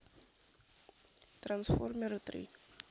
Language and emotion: Russian, neutral